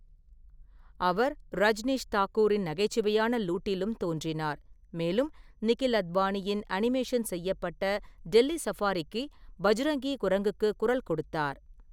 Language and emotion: Tamil, neutral